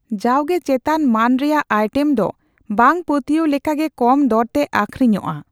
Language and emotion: Santali, neutral